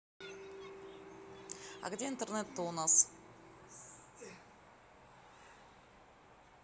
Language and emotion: Russian, neutral